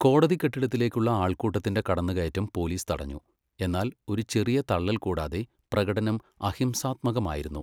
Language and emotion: Malayalam, neutral